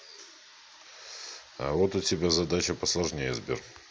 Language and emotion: Russian, neutral